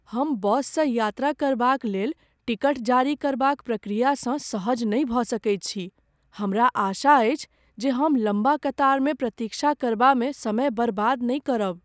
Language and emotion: Maithili, fearful